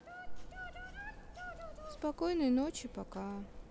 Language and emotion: Russian, sad